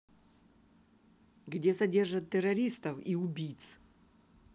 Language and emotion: Russian, angry